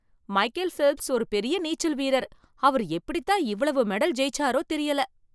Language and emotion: Tamil, surprised